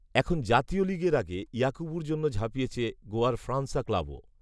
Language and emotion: Bengali, neutral